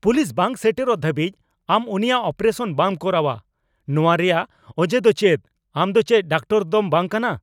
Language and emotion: Santali, angry